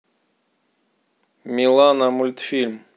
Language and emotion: Russian, neutral